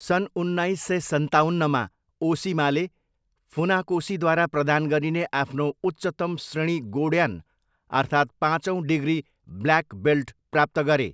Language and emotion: Nepali, neutral